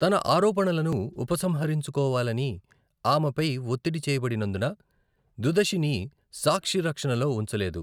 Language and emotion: Telugu, neutral